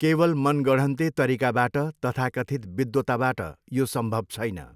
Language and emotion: Nepali, neutral